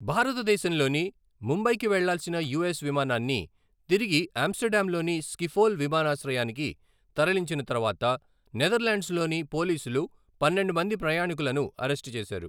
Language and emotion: Telugu, neutral